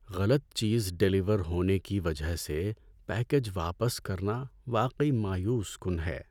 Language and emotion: Urdu, sad